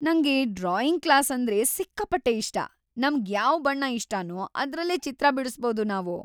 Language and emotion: Kannada, happy